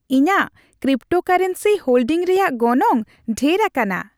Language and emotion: Santali, happy